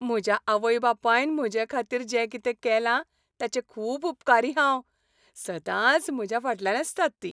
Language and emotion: Goan Konkani, happy